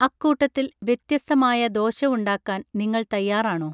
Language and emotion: Malayalam, neutral